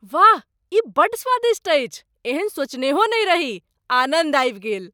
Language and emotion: Maithili, surprised